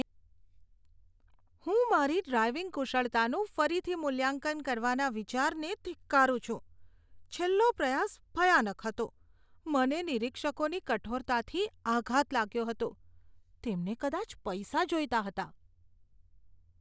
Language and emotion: Gujarati, disgusted